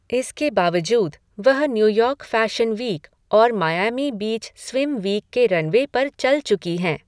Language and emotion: Hindi, neutral